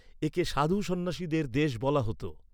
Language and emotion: Bengali, neutral